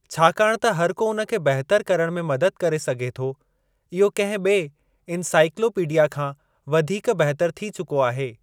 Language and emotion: Sindhi, neutral